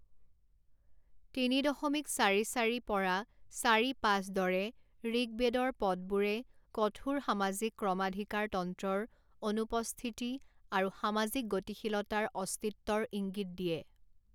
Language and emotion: Assamese, neutral